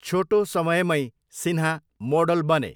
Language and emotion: Nepali, neutral